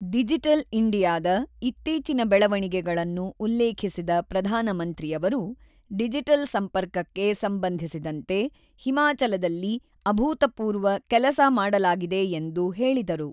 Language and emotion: Kannada, neutral